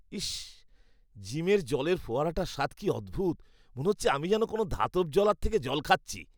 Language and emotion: Bengali, disgusted